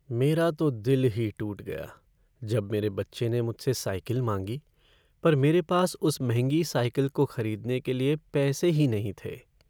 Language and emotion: Hindi, sad